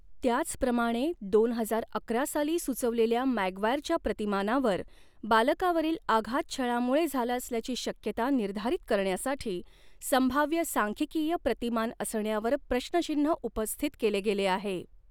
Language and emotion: Marathi, neutral